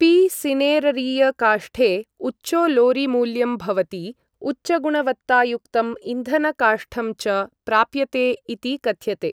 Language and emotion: Sanskrit, neutral